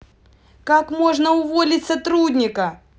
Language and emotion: Russian, angry